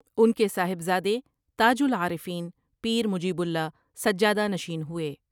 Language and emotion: Urdu, neutral